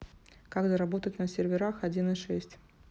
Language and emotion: Russian, neutral